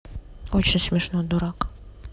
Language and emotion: Russian, sad